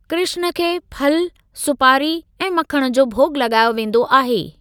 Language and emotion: Sindhi, neutral